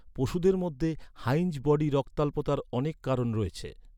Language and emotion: Bengali, neutral